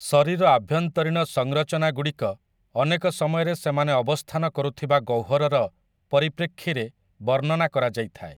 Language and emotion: Odia, neutral